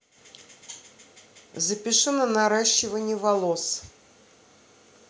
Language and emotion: Russian, neutral